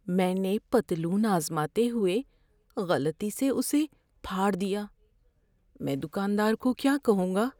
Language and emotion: Urdu, fearful